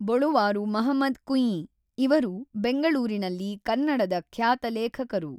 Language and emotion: Kannada, neutral